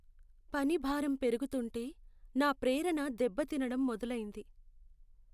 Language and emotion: Telugu, sad